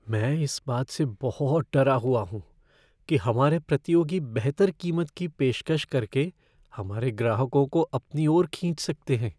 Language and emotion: Hindi, fearful